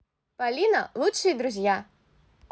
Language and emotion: Russian, positive